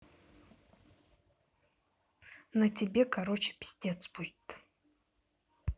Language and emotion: Russian, angry